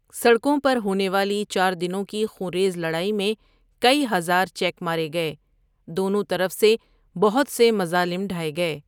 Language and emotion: Urdu, neutral